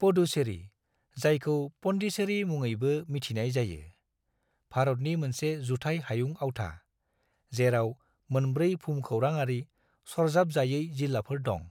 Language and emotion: Bodo, neutral